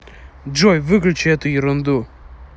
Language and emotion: Russian, angry